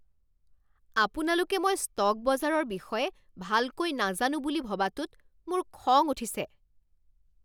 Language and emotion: Assamese, angry